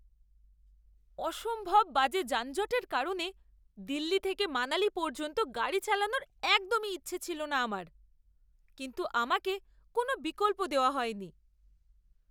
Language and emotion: Bengali, disgusted